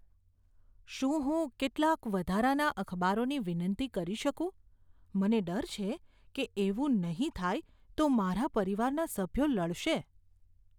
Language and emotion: Gujarati, fearful